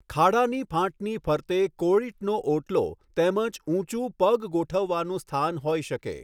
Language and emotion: Gujarati, neutral